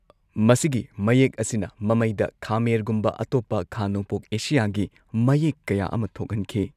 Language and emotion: Manipuri, neutral